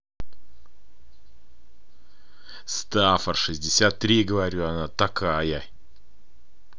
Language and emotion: Russian, angry